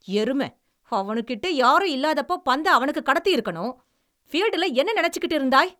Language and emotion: Tamil, angry